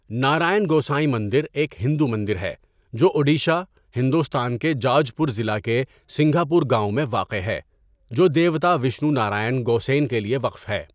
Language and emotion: Urdu, neutral